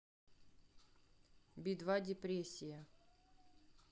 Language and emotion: Russian, neutral